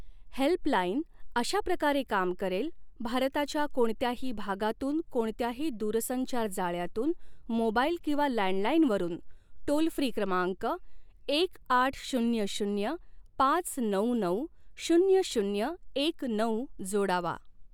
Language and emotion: Marathi, neutral